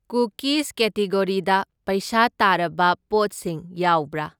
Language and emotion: Manipuri, neutral